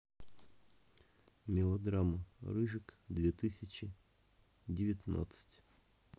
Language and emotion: Russian, neutral